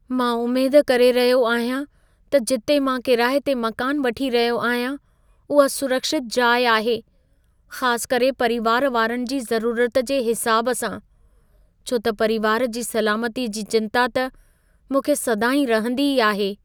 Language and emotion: Sindhi, fearful